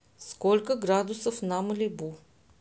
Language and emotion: Russian, neutral